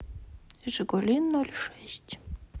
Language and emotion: Russian, neutral